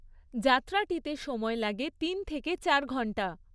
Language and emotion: Bengali, neutral